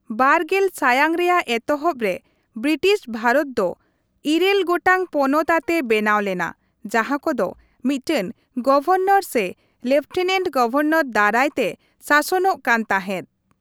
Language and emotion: Santali, neutral